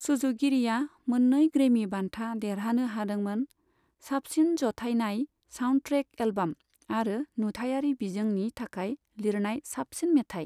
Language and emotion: Bodo, neutral